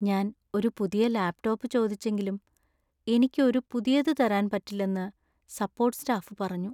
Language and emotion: Malayalam, sad